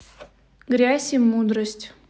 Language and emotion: Russian, neutral